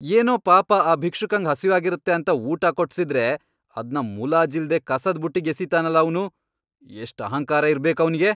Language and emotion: Kannada, angry